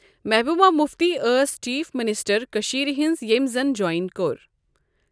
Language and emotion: Kashmiri, neutral